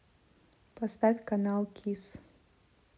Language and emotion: Russian, neutral